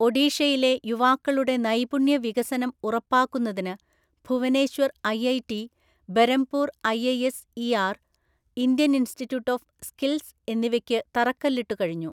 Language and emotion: Malayalam, neutral